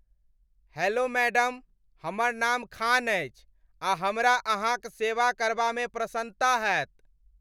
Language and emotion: Maithili, happy